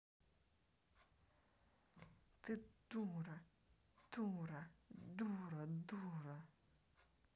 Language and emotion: Russian, angry